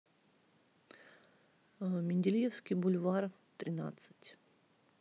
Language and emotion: Russian, neutral